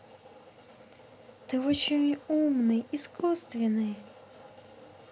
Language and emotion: Russian, positive